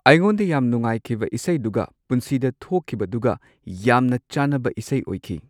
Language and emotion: Manipuri, neutral